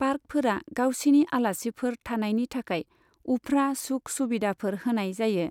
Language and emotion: Bodo, neutral